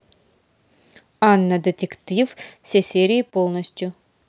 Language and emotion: Russian, neutral